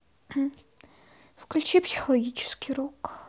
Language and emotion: Russian, neutral